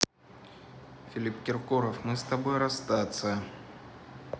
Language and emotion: Russian, neutral